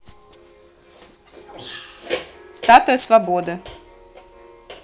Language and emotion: Russian, neutral